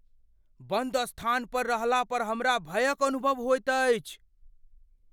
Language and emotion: Maithili, fearful